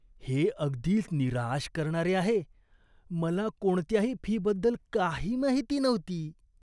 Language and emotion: Marathi, disgusted